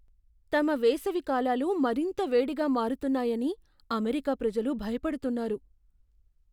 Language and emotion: Telugu, fearful